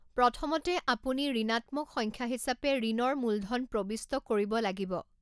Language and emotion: Assamese, neutral